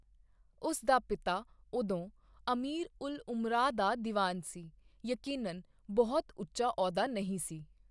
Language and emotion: Punjabi, neutral